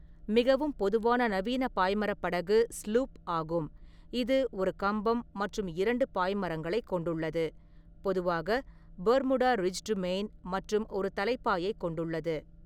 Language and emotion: Tamil, neutral